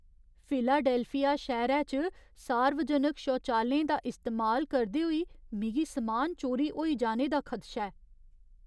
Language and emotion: Dogri, fearful